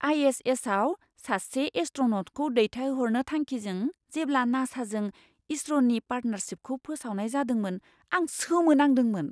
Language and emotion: Bodo, surprised